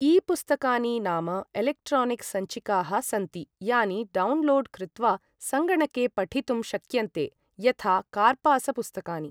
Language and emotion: Sanskrit, neutral